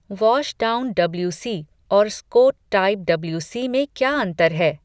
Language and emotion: Hindi, neutral